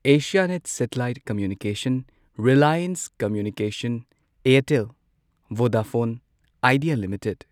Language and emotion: Manipuri, neutral